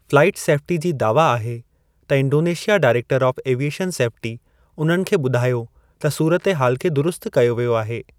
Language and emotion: Sindhi, neutral